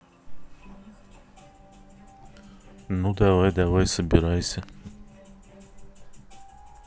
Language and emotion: Russian, neutral